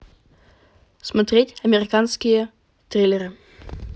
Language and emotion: Russian, neutral